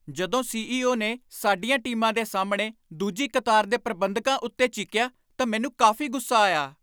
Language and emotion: Punjabi, angry